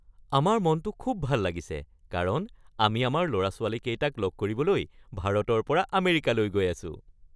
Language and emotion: Assamese, happy